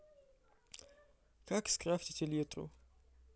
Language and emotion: Russian, neutral